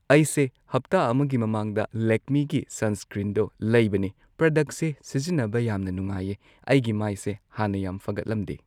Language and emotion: Manipuri, neutral